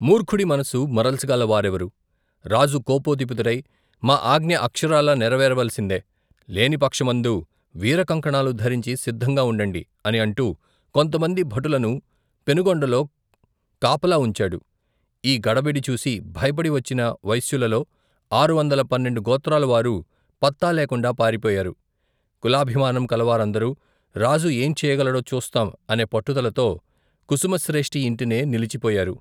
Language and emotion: Telugu, neutral